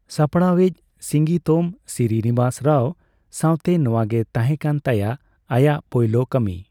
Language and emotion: Santali, neutral